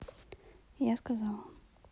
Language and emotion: Russian, sad